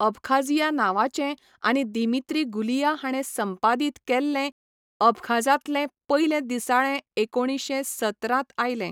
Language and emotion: Goan Konkani, neutral